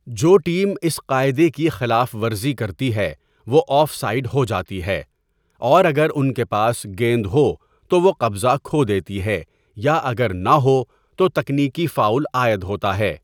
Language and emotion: Urdu, neutral